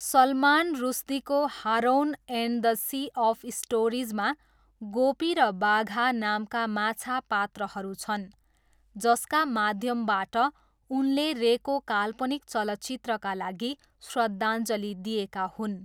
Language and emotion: Nepali, neutral